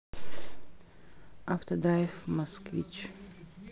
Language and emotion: Russian, neutral